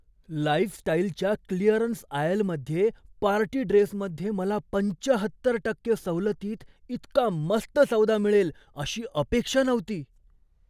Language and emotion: Marathi, surprised